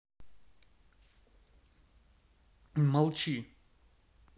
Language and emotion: Russian, angry